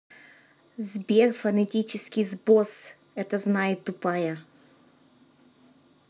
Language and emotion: Russian, angry